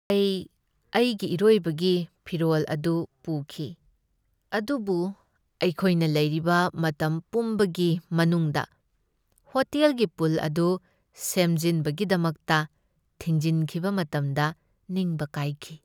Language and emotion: Manipuri, sad